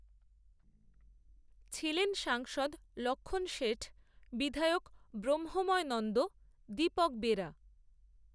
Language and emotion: Bengali, neutral